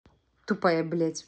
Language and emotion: Russian, angry